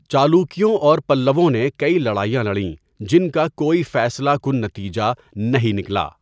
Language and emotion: Urdu, neutral